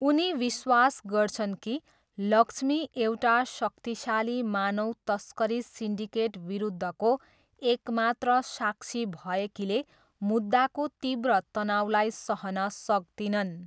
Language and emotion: Nepali, neutral